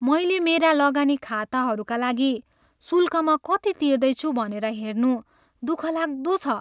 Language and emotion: Nepali, sad